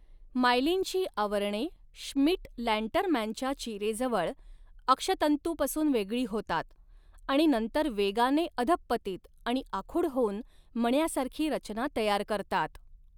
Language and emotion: Marathi, neutral